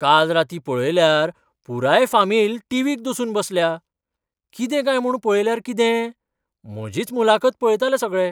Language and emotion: Goan Konkani, surprised